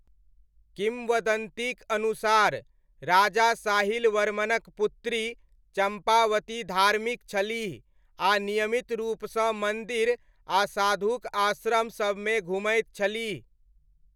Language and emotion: Maithili, neutral